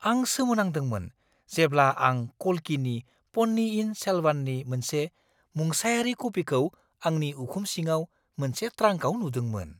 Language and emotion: Bodo, surprised